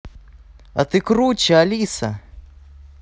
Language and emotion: Russian, positive